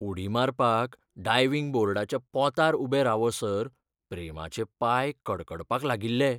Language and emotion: Goan Konkani, fearful